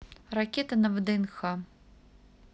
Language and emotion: Russian, neutral